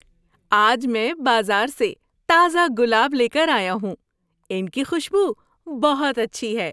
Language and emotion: Urdu, happy